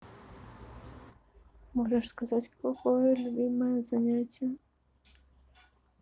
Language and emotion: Russian, neutral